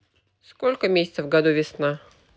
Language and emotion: Russian, neutral